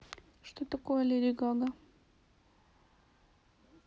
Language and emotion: Russian, neutral